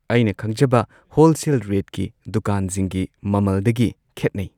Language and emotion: Manipuri, neutral